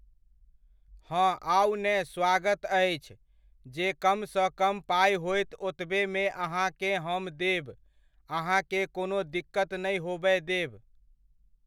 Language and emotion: Maithili, neutral